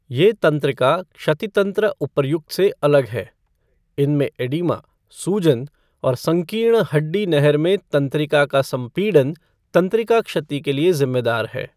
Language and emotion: Hindi, neutral